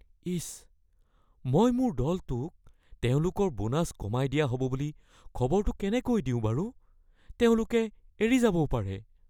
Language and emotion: Assamese, fearful